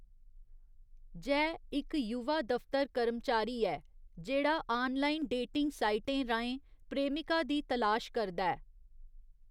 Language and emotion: Dogri, neutral